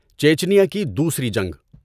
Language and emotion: Urdu, neutral